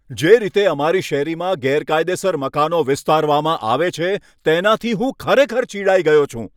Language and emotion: Gujarati, angry